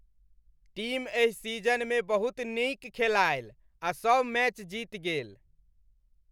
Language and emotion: Maithili, happy